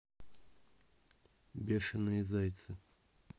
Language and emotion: Russian, neutral